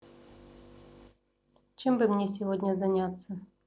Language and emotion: Russian, neutral